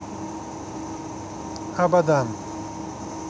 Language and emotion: Russian, neutral